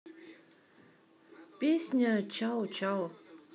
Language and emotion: Russian, neutral